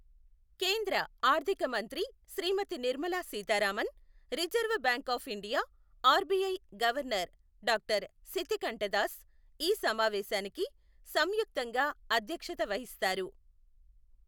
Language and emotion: Telugu, neutral